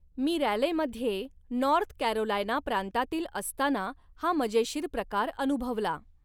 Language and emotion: Marathi, neutral